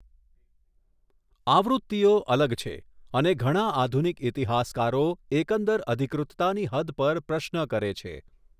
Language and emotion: Gujarati, neutral